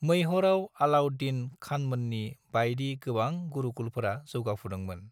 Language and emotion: Bodo, neutral